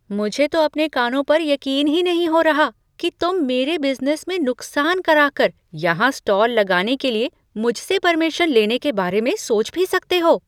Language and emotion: Hindi, surprised